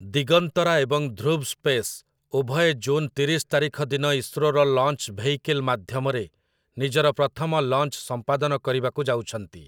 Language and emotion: Odia, neutral